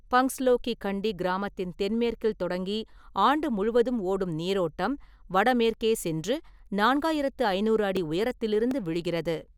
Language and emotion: Tamil, neutral